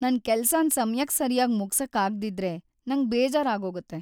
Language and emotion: Kannada, sad